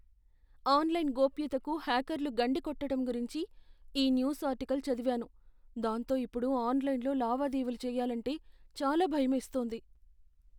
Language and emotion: Telugu, fearful